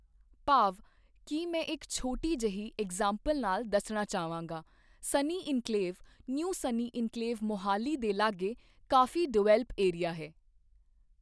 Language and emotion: Punjabi, neutral